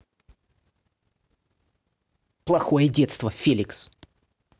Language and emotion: Russian, angry